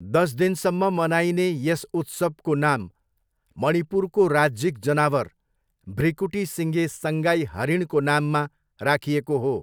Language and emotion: Nepali, neutral